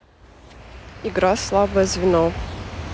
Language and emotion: Russian, neutral